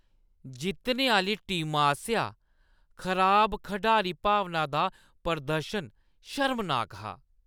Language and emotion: Dogri, disgusted